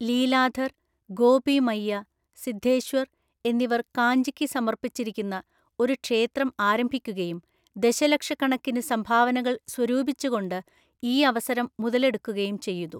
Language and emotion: Malayalam, neutral